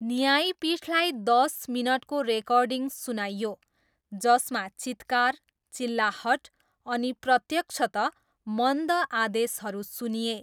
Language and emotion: Nepali, neutral